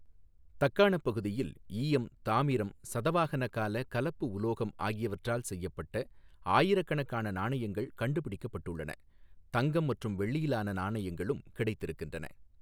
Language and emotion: Tamil, neutral